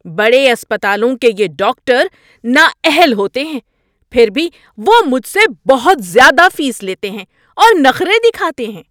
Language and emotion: Urdu, angry